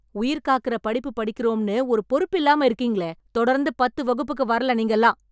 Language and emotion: Tamil, angry